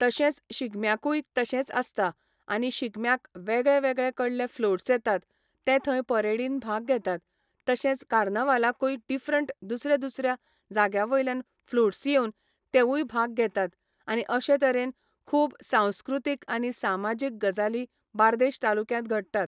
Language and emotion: Goan Konkani, neutral